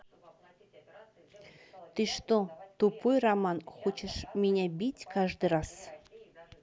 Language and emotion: Russian, neutral